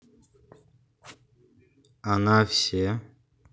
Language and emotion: Russian, neutral